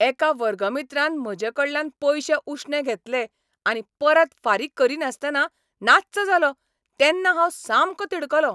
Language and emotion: Goan Konkani, angry